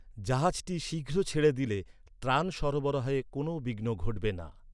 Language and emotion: Bengali, neutral